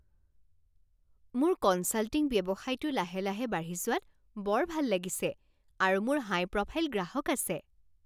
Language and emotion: Assamese, happy